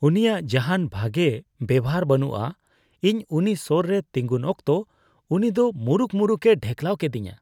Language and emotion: Santali, disgusted